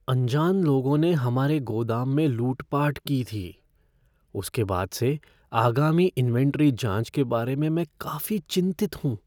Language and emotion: Hindi, fearful